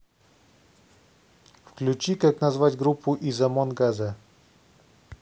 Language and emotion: Russian, neutral